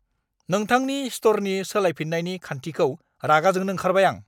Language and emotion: Bodo, angry